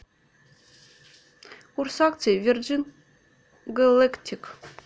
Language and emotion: Russian, neutral